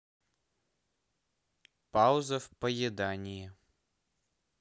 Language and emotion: Russian, neutral